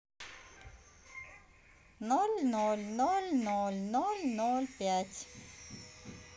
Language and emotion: Russian, neutral